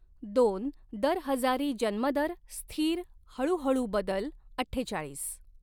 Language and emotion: Marathi, neutral